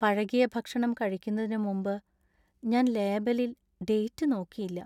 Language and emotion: Malayalam, sad